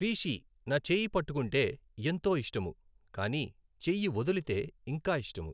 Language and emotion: Telugu, neutral